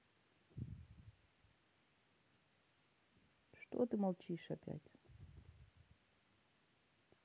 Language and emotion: Russian, neutral